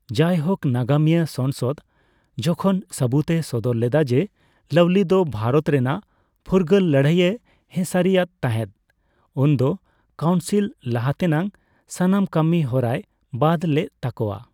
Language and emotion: Santali, neutral